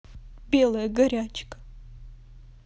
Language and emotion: Russian, sad